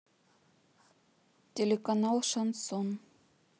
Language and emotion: Russian, neutral